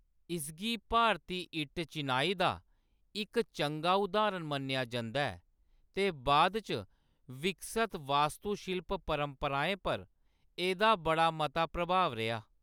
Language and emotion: Dogri, neutral